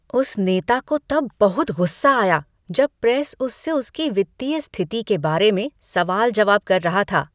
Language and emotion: Hindi, angry